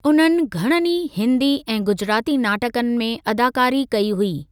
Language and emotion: Sindhi, neutral